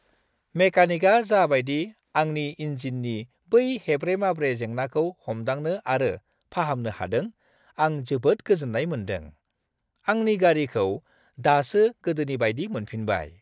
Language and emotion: Bodo, happy